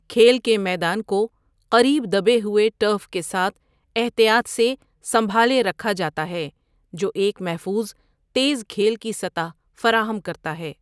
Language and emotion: Urdu, neutral